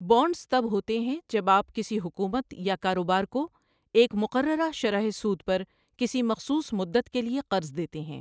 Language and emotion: Urdu, neutral